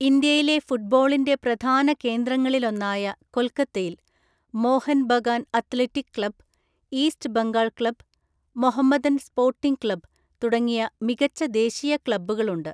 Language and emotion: Malayalam, neutral